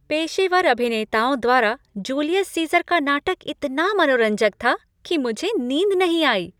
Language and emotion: Hindi, happy